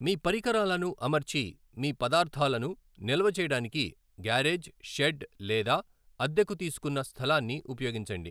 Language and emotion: Telugu, neutral